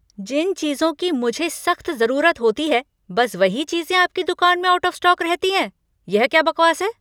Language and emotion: Hindi, angry